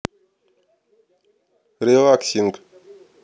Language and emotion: Russian, neutral